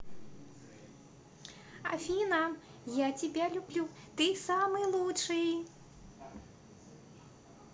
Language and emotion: Russian, positive